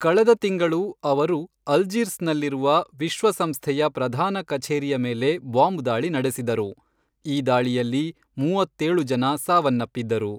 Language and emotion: Kannada, neutral